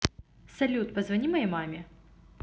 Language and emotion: Russian, positive